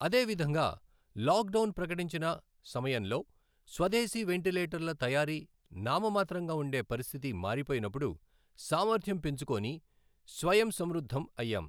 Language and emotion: Telugu, neutral